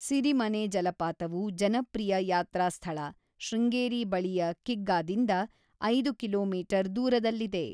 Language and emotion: Kannada, neutral